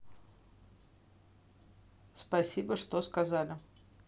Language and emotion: Russian, neutral